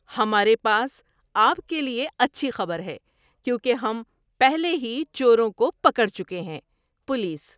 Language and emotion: Urdu, happy